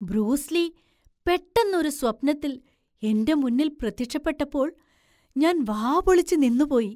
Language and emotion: Malayalam, surprised